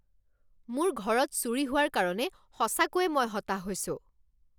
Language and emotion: Assamese, angry